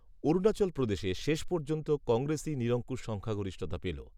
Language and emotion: Bengali, neutral